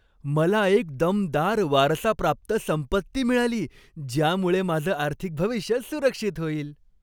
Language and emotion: Marathi, happy